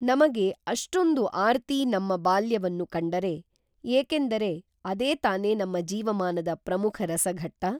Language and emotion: Kannada, neutral